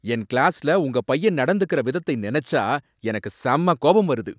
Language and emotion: Tamil, angry